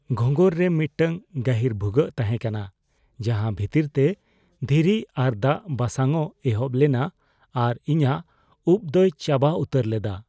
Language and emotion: Santali, fearful